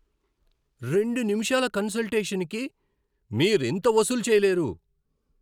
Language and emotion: Telugu, angry